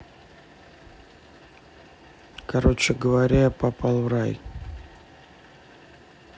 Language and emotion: Russian, neutral